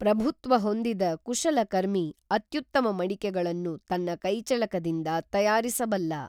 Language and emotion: Kannada, neutral